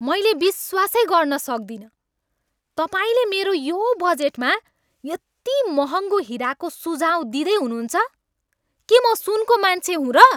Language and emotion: Nepali, angry